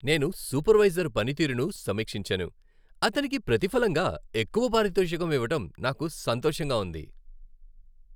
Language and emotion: Telugu, happy